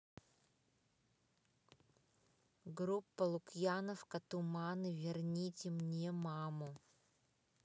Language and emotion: Russian, neutral